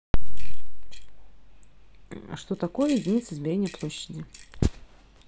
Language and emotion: Russian, neutral